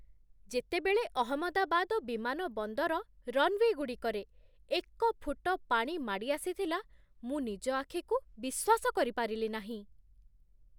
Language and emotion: Odia, surprised